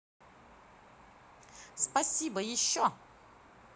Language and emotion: Russian, positive